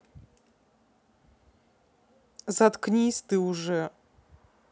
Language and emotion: Russian, neutral